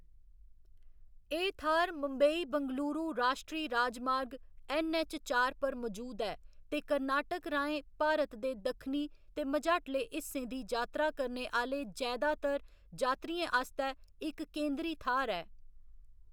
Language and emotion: Dogri, neutral